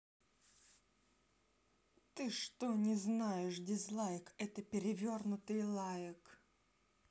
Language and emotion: Russian, angry